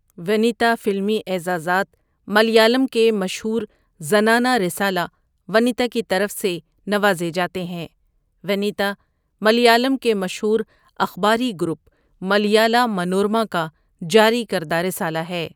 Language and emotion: Urdu, neutral